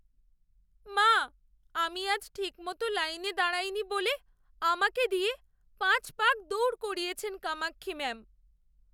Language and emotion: Bengali, sad